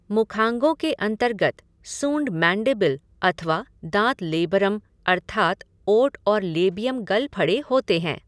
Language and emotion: Hindi, neutral